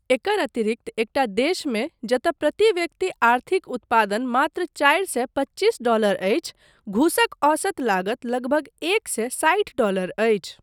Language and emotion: Maithili, neutral